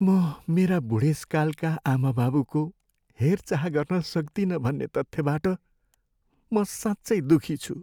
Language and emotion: Nepali, sad